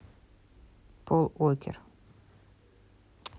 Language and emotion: Russian, neutral